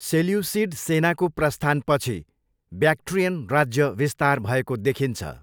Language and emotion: Nepali, neutral